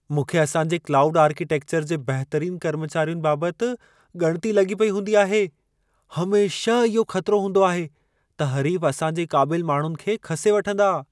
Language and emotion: Sindhi, fearful